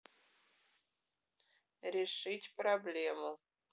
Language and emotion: Russian, neutral